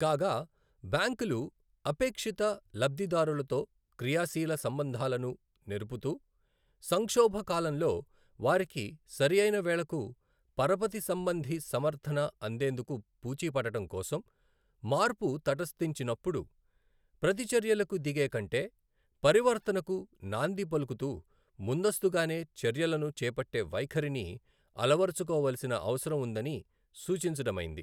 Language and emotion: Telugu, neutral